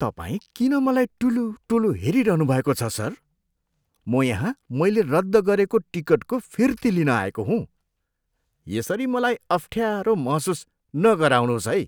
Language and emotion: Nepali, disgusted